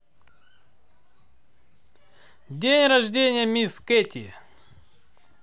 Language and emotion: Russian, positive